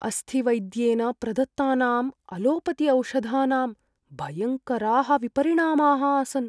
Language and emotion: Sanskrit, fearful